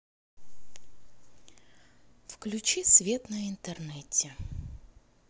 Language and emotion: Russian, neutral